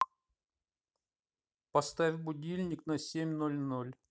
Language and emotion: Russian, neutral